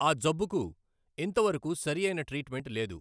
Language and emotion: Telugu, neutral